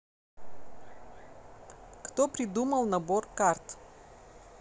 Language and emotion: Russian, neutral